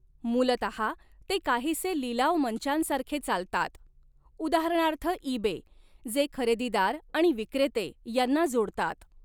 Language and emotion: Marathi, neutral